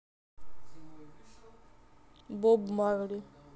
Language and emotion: Russian, neutral